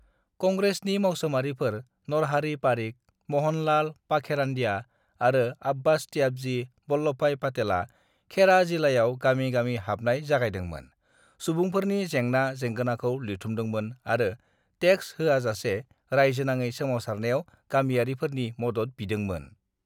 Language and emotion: Bodo, neutral